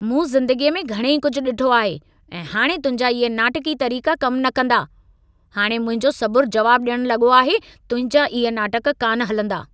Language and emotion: Sindhi, angry